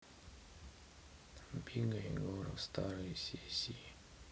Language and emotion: Russian, sad